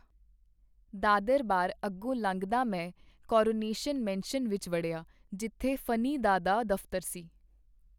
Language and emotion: Punjabi, neutral